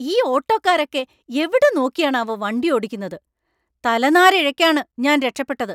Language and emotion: Malayalam, angry